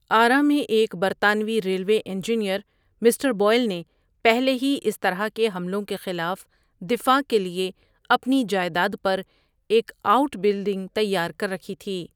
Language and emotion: Urdu, neutral